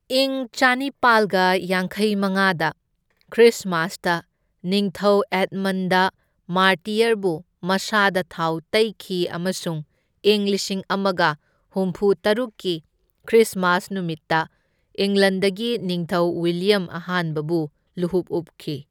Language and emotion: Manipuri, neutral